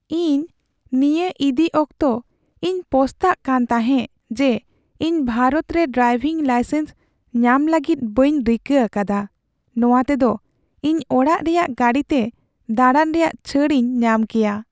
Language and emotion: Santali, sad